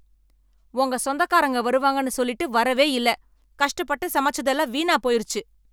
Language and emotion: Tamil, angry